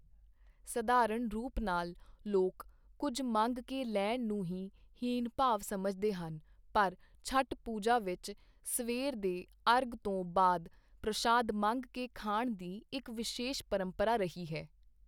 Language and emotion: Punjabi, neutral